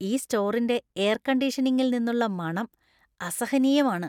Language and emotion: Malayalam, disgusted